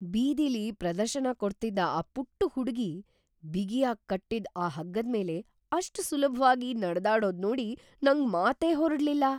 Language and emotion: Kannada, surprised